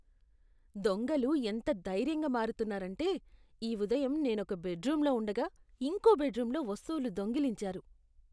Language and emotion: Telugu, disgusted